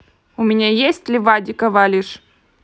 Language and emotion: Russian, neutral